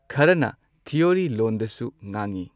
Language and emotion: Manipuri, neutral